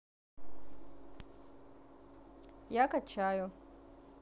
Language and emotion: Russian, neutral